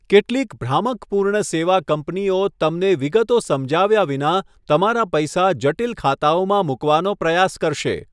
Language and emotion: Gujarati, neutral